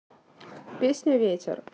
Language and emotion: Russian, neutral